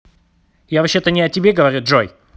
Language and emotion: Russian, angry